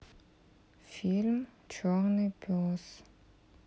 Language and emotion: Russian, neutral